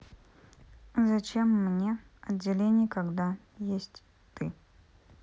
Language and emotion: Russian, neutral